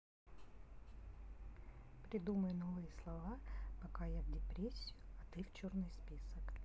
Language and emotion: Russian, neutral